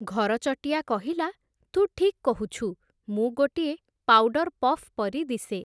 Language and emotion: Odia, neutral